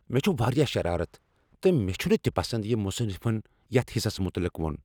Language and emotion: Kashmiri, angry